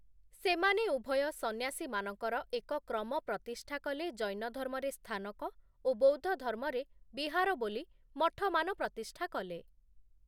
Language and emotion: Odia, neutral